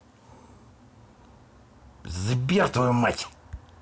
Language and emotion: Russian, angry